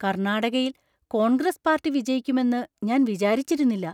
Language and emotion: Malayalam, surprised